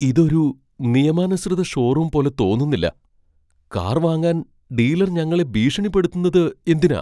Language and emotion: Malayalam, fearful